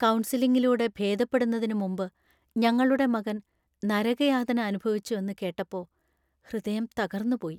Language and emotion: Malayalam, sad